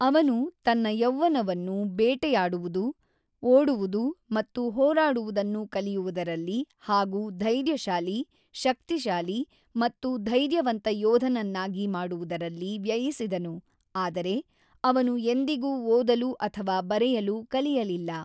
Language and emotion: Kannada, neutral